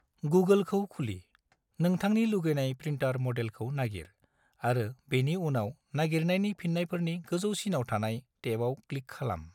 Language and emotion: Bodo, neutral